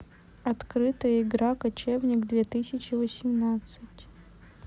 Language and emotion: Russian, neutral